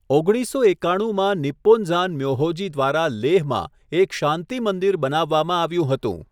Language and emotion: Gujarati, neutral